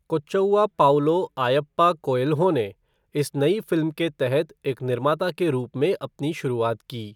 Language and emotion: Hindi, neutral